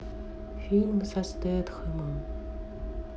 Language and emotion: Russian, sad